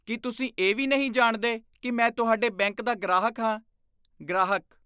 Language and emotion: Punjabi, disgusted